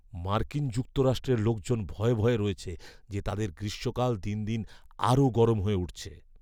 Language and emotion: Bengali, fearful